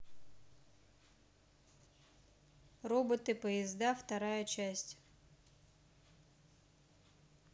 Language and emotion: Russian, neutral